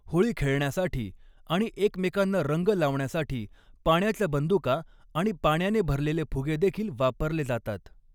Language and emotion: Marathi, neutral